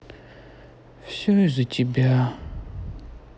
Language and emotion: Russian, sad